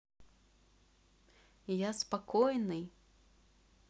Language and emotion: Russian, neutral